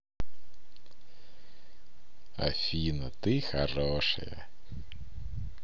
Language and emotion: Russian, positive